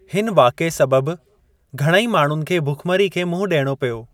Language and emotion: Sindhi, neutral